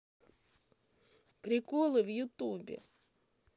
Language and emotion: Russian, sad